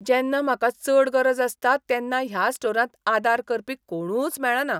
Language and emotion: Goan Konkani, disgusted